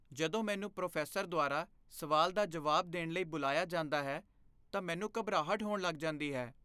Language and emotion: Punjabi, fearful